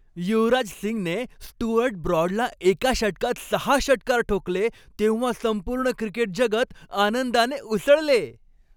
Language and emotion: Marathi, happy